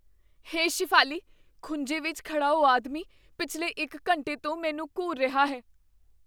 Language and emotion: Punjabi, fearful